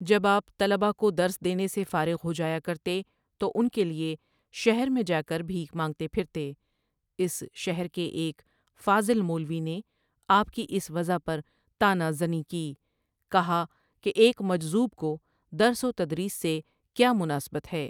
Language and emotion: Urdu, neutral